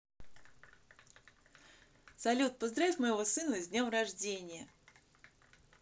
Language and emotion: Russian, positive